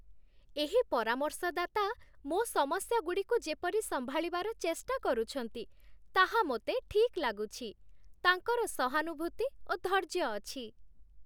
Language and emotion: Odia, happy